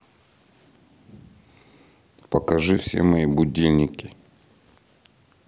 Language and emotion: Russian, neutral